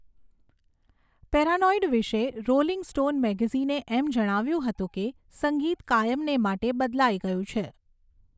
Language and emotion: Gujarati, neutral